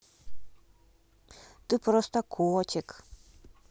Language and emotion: Russian, positive